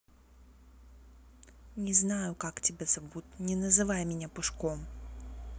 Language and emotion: Russian, angry